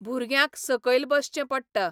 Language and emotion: Goan Konkani, neutral